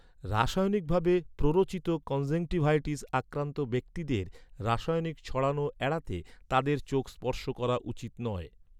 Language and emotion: Bengali, neutral